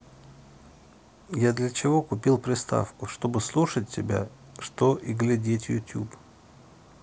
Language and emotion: Russian, neutral